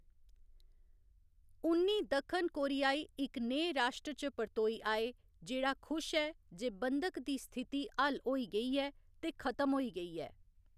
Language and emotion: Dogri, neutral